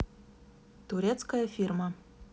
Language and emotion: Russian, neutral